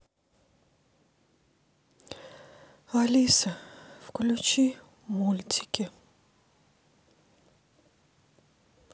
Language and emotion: Russian, sad